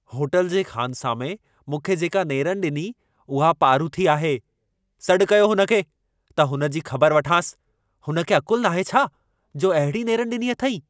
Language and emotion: Sindhi, angry